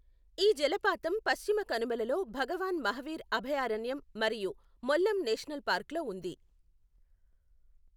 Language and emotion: Telugu, neutral